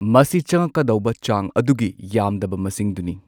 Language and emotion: Manipuri, neutral